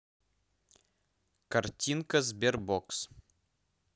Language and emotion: Russian, neutral